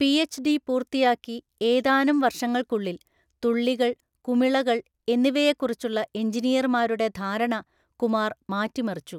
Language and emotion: Malayalam, neutral